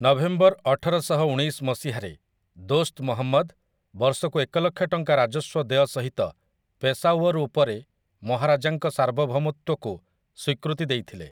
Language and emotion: Odia, neutral